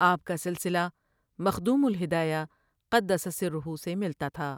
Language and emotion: Urdu, neutral